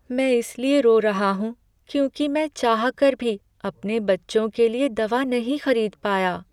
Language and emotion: Hindi, sad